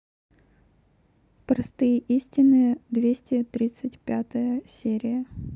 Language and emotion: Russian, neutral